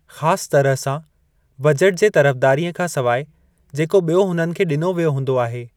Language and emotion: Sindhi, neutral